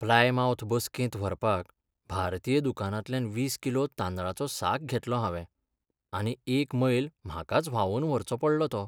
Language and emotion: Goan Konkani, sad